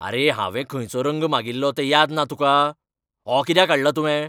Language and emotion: Goan Konkani, angry